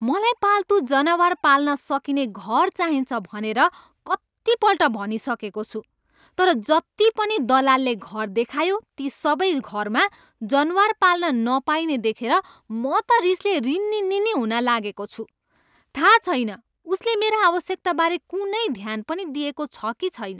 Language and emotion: Nepali, angry